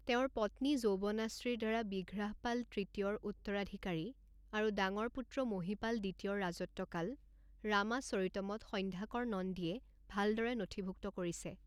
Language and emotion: Assamese, neutral